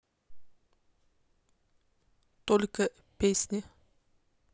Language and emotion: Russian, neutral